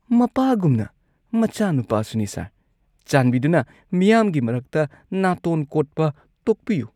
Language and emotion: Manipuri, disgusted